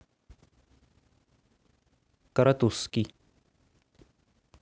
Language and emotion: Russian, neutral